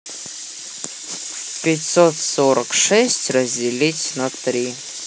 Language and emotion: Russian, neutral